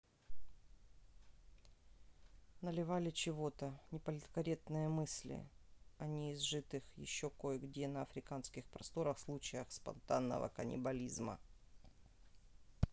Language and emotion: Russian, neutral